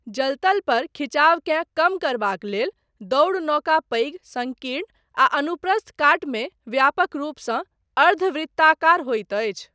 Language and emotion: Maithili, neutral